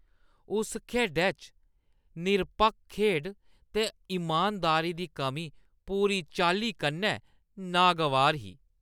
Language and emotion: Dogri, disgusted